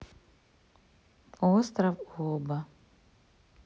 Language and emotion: Russian, neutral